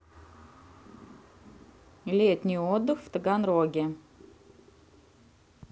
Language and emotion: Russian, neutral